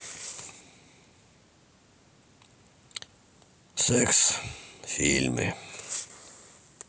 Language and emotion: Russian, sad